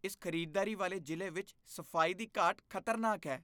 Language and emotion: Punjabi, disgusted